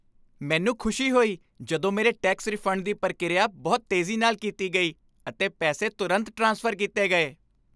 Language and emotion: Punjabi, happy